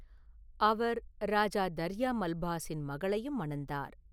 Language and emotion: Tamil, neutral